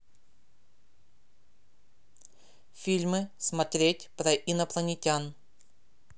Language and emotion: Russian, neutral